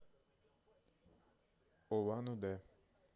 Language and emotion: Russian, neutral